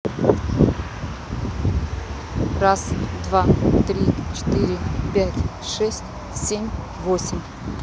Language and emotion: Russian, neutral